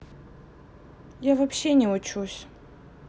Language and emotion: Russian, neutral